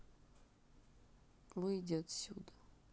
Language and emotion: Russian, sad